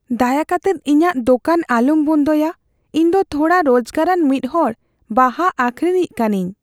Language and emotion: Santali, fearful